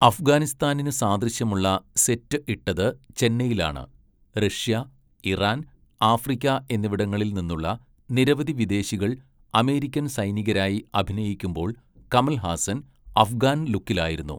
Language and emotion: Malayalam, neutral